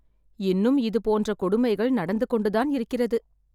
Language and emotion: Tamil, sad